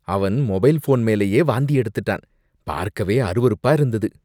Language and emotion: Tamil, disgusted